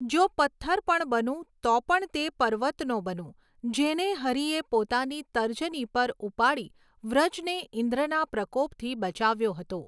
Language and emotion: Gujarati, neutral